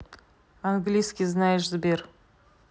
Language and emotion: Russian, neutral